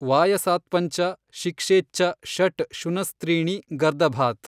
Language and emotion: Kannada, neutral